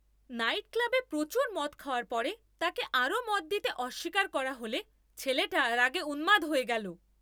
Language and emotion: Bengali, angry